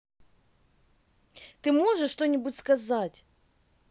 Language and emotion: Russian, angry